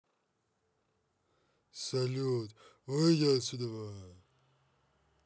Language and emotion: Russian, angry